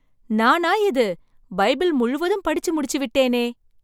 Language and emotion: Tamil, surprised